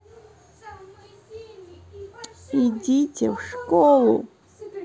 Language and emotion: Russian, angry